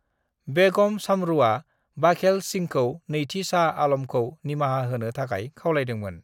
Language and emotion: Bodo, neutral